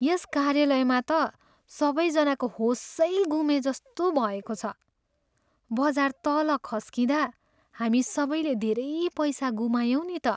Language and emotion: Nepali, sad